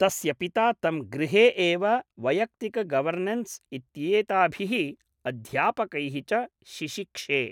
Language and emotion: Sanskrit, neutral